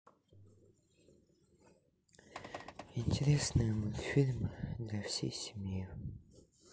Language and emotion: Russian, sad